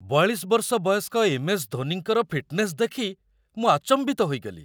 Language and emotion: Odia, surprised